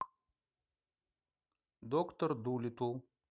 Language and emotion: Russian, neutral